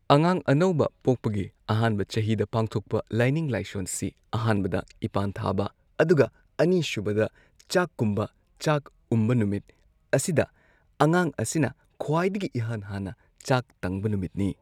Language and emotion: Manipuri, neutral